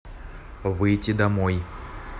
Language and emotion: Russian, neutral